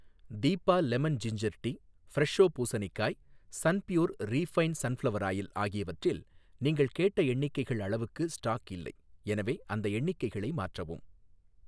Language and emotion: Tamil, neutral